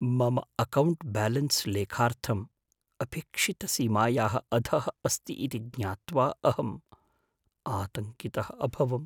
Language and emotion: Sanskrit, fearful